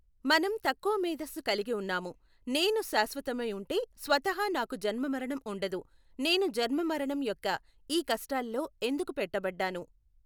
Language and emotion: Telugu, neutral